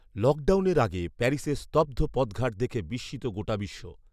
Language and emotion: Bengali, neutral